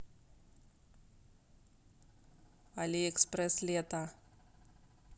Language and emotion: Russian, neutral